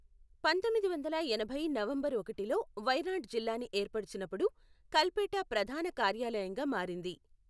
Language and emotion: Telugu, neutral